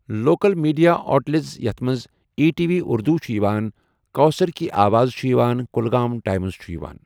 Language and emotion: Kashmiri, neutral